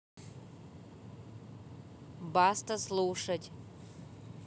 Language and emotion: Russian, neutral